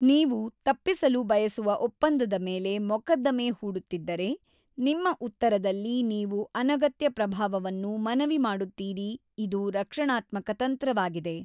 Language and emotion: Kannada, neutral